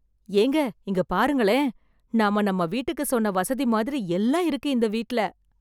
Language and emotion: Tamil, surprised